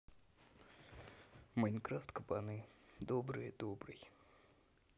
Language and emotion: Russian, neutral